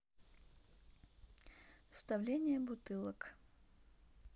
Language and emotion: Russian, neutral